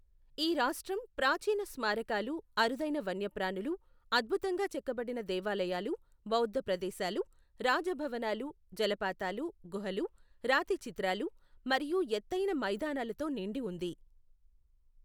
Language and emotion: Telugu, neutral